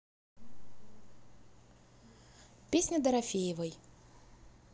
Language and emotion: Russian, neutral